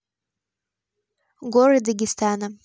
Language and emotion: Russian, neutral